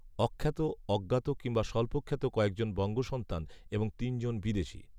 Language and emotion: Bengali, neutral